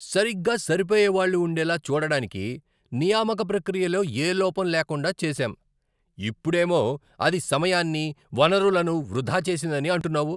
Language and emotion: Telugu, angry